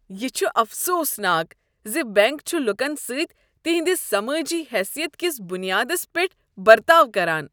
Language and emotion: Kashmiri, disgusted